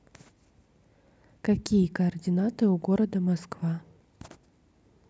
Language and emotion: Russian, neutral